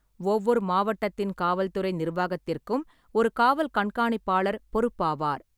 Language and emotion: Tamil, neutral